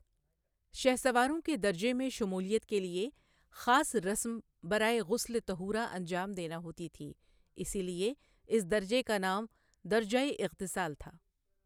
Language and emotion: Urdu, neutral